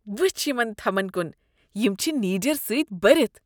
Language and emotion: Kashmiri, disgusted